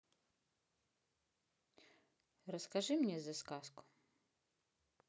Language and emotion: Russian, neutral